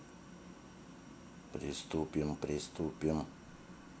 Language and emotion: Russian, neutral